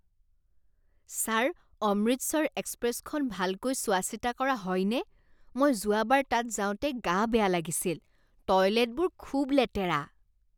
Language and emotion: Assamese, disgusted